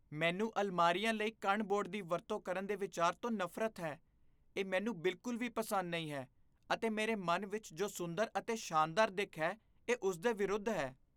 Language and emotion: Punjabi, disgusted